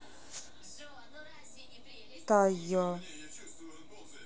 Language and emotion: Russian, neutral